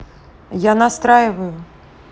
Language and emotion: Russian, neutral